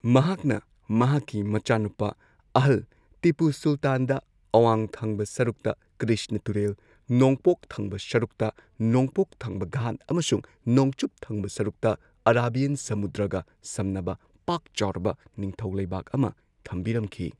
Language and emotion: Manipuri, neutral